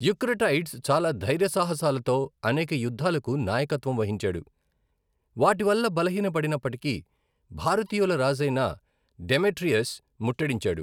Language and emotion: Telugu, neutral